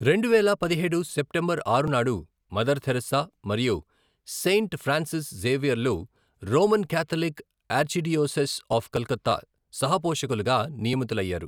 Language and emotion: Telugu, neutral